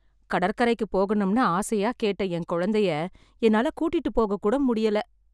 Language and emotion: Tamil, sad